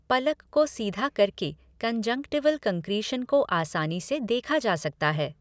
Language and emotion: Hindi, neutral